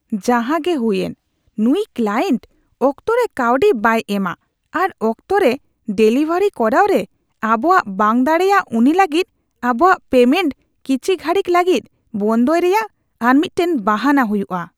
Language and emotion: Santali, disgusted